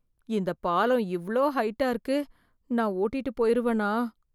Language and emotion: Tamil, fearful